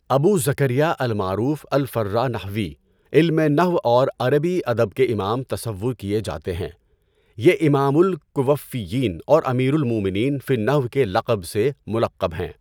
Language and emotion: Urdu, neutral